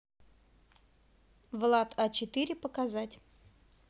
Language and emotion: Russian, neutral